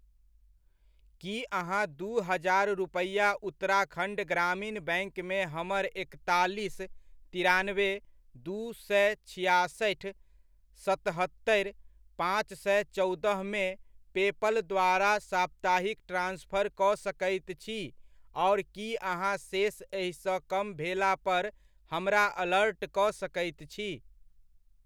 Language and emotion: Maithili, neutral